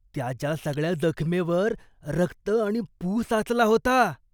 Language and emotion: Marathi, disgusted